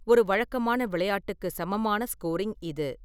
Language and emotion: Tamil, neutral